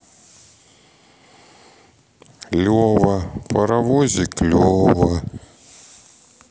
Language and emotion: Russian, sad